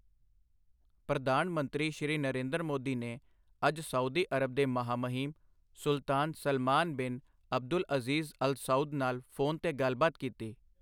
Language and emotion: Punjabi, neutral